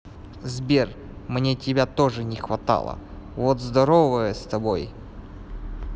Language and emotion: Russian, neutral